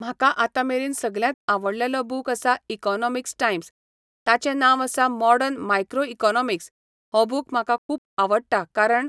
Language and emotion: Goan Konkani, neutral